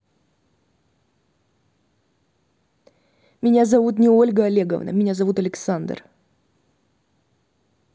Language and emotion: Russian, angry